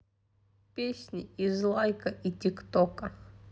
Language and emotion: Russian, neutral